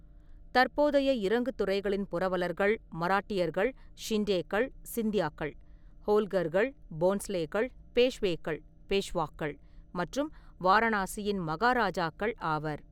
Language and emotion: Tamil, neutral